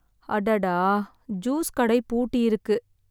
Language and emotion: Tamil, sad